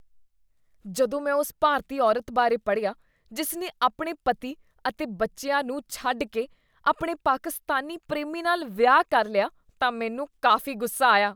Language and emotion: Punjabi, disgusted